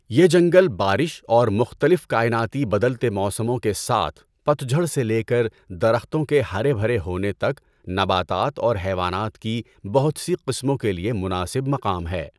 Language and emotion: Urdu, neutral